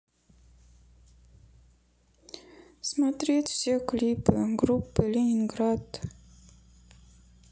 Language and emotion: Russian, sad